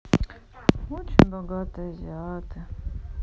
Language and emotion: Russian, sad